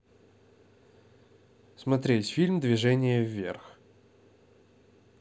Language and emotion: Russian, neutral